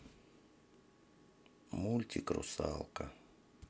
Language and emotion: Russian, sad